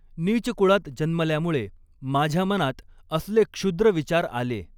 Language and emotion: Marathi, neutral